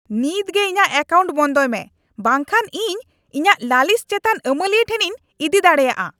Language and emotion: Santali, angry